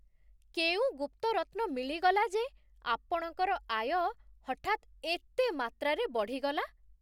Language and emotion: Odia, surprised